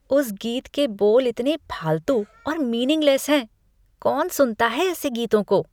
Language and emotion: Hindi, disgusted